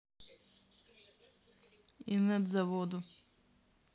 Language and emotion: Russian, neutral